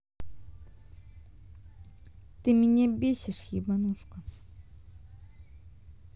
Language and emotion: Russian, angry